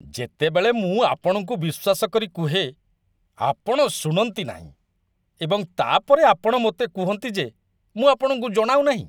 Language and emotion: Odia, disgusted